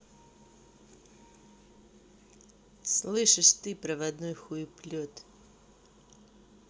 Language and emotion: Russian, angry